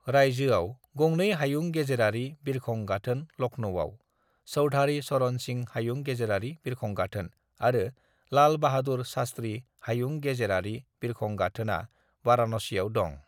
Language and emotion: Bodo, neutral